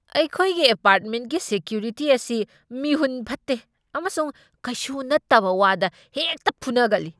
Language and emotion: Manipuri, angry